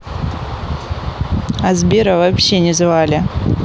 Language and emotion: Russian, neutral